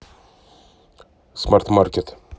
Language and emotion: Russian, neutral